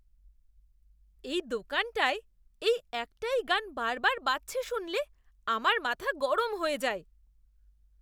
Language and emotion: Bengali, disgusted